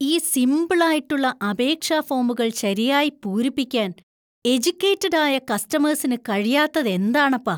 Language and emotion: Malayalam, disgusted